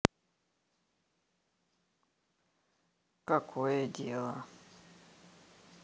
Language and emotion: Russian, neutral